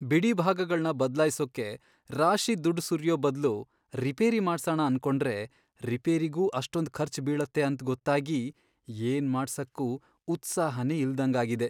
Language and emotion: Kannada, sad